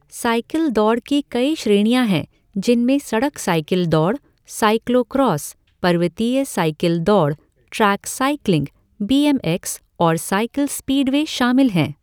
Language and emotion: Hindi, neutral